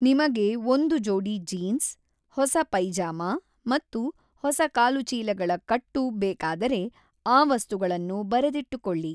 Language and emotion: Kannada, neutral